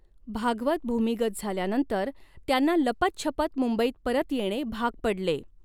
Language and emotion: Marathi, neutral